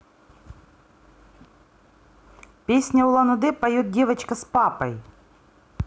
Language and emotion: Russian, neutral